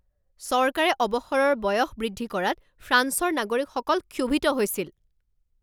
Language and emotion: Assamese, angry